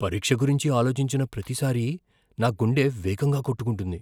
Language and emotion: Telugu, fearful